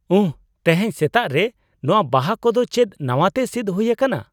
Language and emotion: Santali, surprised